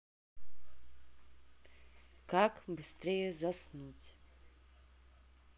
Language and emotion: Russian, neutral